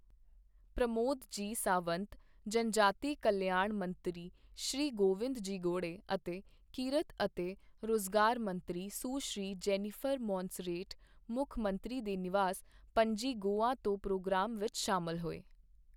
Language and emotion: Punjabi, neutral